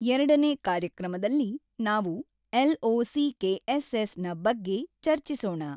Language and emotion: Kannada, neutral